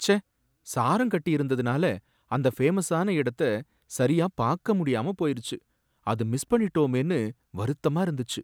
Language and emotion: Tamil, sad